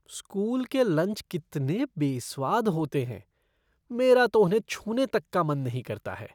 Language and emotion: Hindi, disgusted